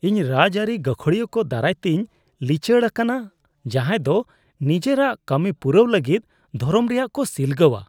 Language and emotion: Santali, disgusted